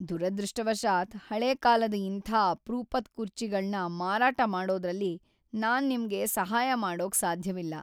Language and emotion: Kannada, sad